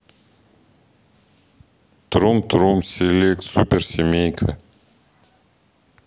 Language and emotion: Russian, neutral